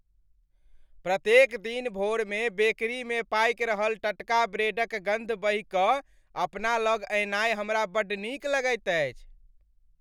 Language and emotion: Maithili, happy